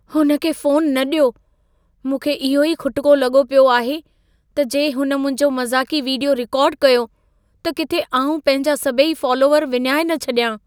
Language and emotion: Sindhi, fearful